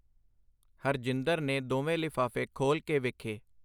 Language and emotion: Punjabi, neutral